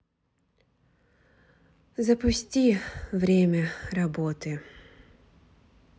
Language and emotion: Russian, sad